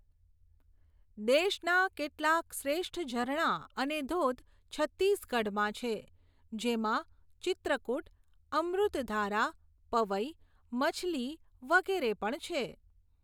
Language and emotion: Gujarati, neutral